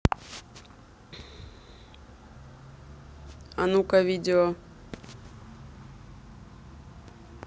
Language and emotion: Russian, neutral